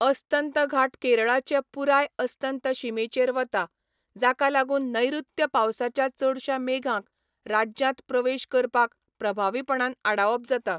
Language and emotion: Goan Konkani, neutral